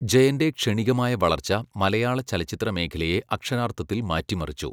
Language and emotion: Malayalam, neutral